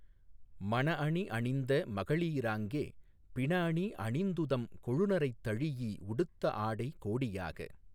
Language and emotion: Tamil, neutral